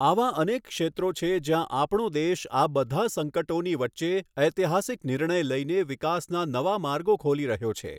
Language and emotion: Gujarati, neutral